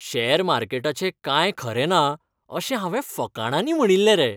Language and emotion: Goan Konkani, happy